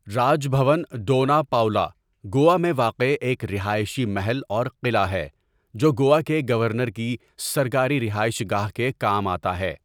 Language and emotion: Urdu, neutral